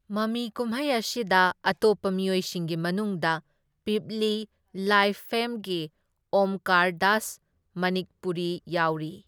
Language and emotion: Manipuri, neutral